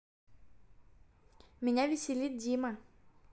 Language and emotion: Russian, positive